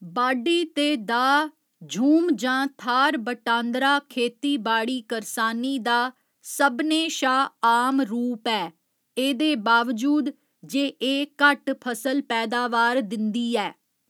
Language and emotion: Dogri, neutral